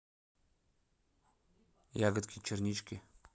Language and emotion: Russian, neutral